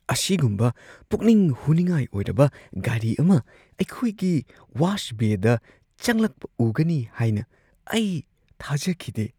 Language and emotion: Manipuri, surprised